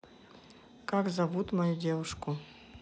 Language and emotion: Russian, neutral